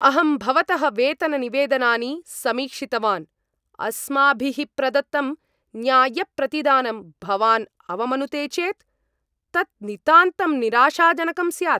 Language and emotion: Sanskrit, angry